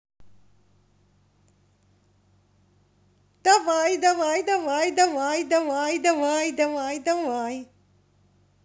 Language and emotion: Russian, positive